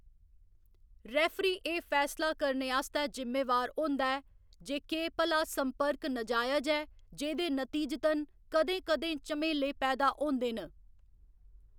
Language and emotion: Dogri, neutral